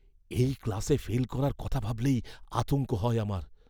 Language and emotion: Bengali, fearful